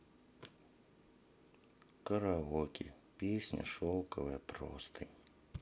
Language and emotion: Russian, sad